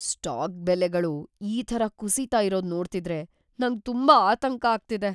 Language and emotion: Kannada, fearful